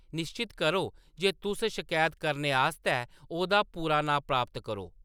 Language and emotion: Dogri, neutral